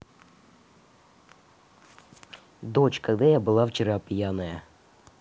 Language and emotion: Russian, neutral